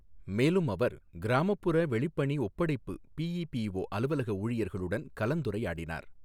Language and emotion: Tamil, neutral